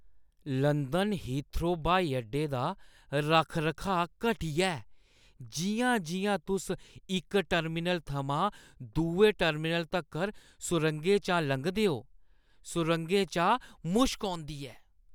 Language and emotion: Dogri, disgusted